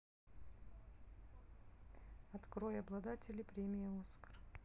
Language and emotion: Russian, neutral